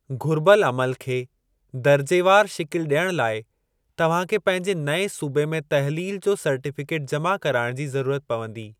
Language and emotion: Sindhi, neutral